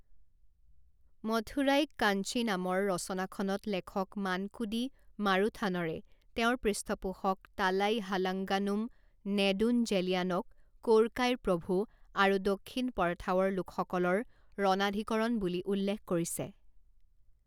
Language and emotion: Assamese, neutral